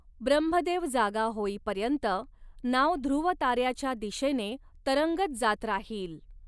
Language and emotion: Marathi, neutral